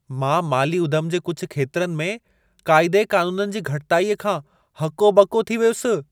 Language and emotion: Sindhi, surprised